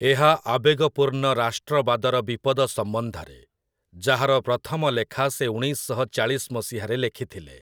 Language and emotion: Odia, neutral